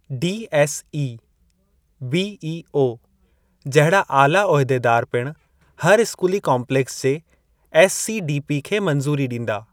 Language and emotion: Sindhi, neutral